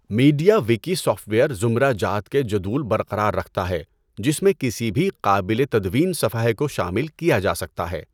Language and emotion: Urdu, neutral